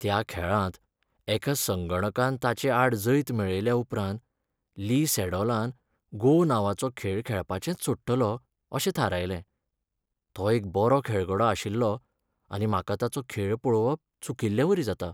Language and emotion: Goan Konkani, sad